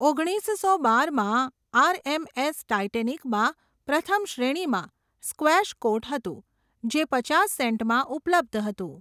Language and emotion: Gujarati, neutral